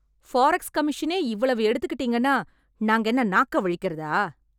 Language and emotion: Tamil, angry